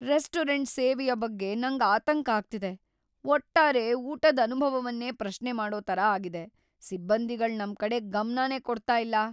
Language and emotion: Kannada, fearful